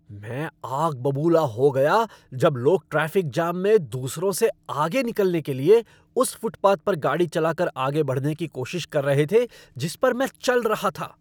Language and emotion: Hindi, angry